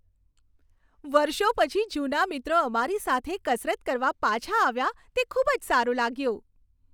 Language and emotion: Gujarati, happy